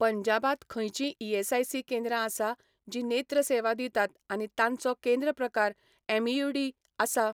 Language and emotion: Goan Konkani, neutral